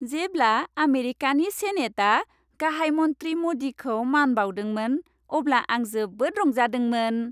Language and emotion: Bodo, happy